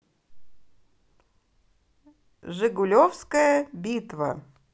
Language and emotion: Russian, positive